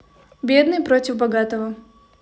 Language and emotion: Russian, neutral